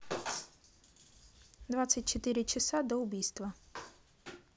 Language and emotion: Russian, neutral